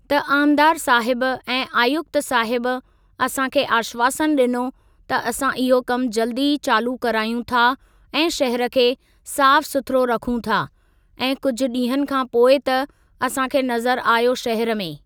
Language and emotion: Sindhi, neutral